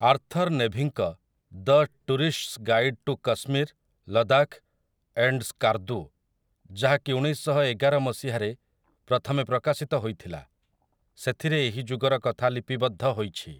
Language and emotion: Odia, neutral